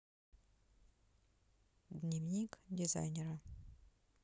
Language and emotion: Russian, neutral